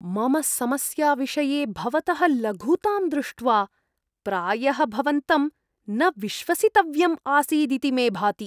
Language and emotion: Sanskrit, disgusted